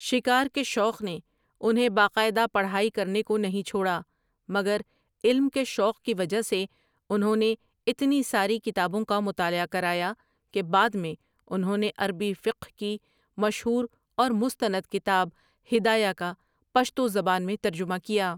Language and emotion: Urdu, neutral